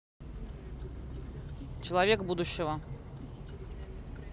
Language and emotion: Russian, neutral